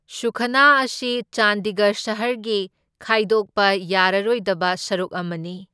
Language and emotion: Manipuri, neutral